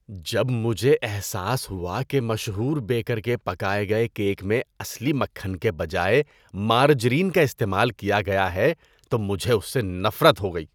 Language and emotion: Urdu, disgusted